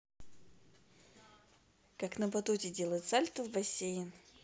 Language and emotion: Russian, positive